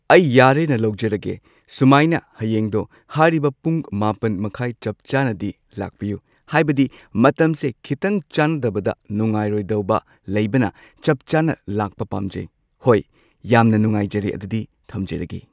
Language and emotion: Manipuri, neutral